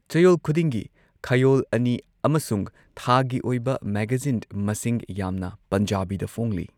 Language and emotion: Manipuri, neutral